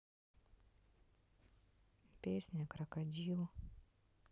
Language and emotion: Russian, sad